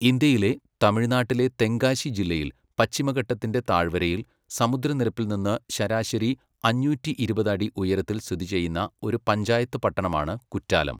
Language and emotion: Malayalam, neutral